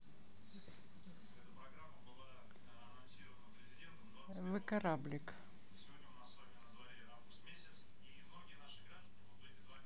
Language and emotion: Russian, neutral